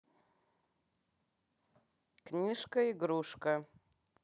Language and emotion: Russian, neutral